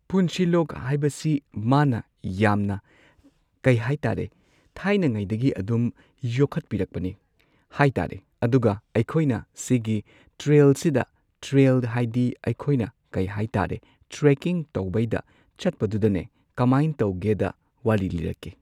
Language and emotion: Manipuri, neutral